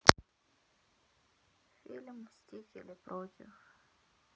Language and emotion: Russian, sad